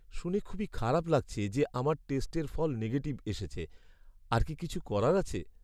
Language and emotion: Bengali, sad